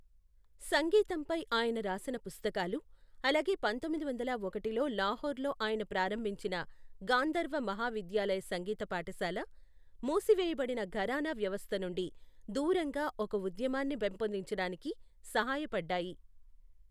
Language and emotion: Telugu, neutral